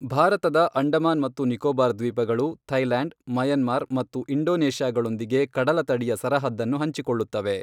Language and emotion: Kannada, neutral